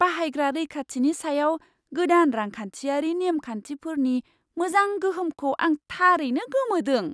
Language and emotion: Bodo, surprised